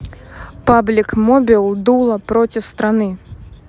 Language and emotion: Russian, neutral